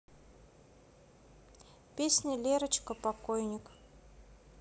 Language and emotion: Russian, neutral